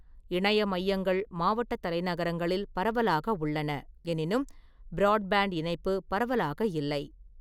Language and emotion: Tamil, neutral